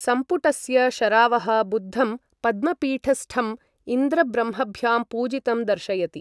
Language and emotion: Sanskrit, neutral